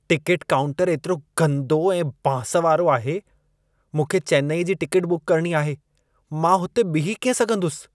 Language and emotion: Sindhi, disgusted